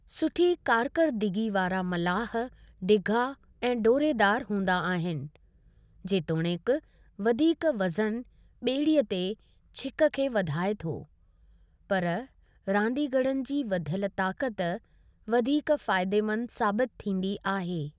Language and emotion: Sindhi, neutral